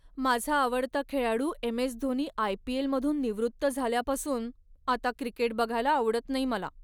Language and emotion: Marathi, sad